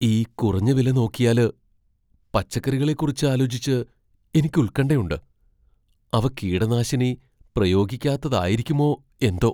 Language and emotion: Malayalam, fearful